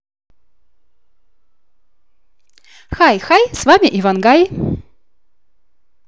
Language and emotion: Russian, positive